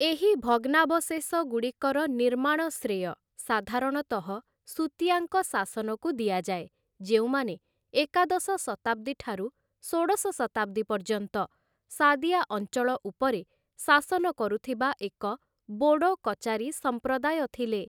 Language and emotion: Odia, neutral